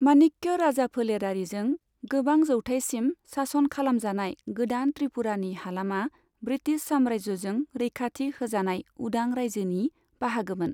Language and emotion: Bodo, neutral